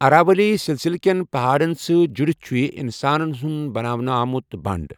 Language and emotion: Kashmiri, neutral